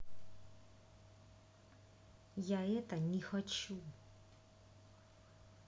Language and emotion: Russian, angry